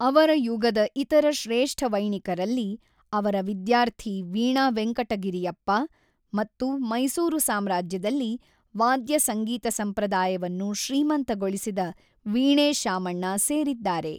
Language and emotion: Kannada, neutral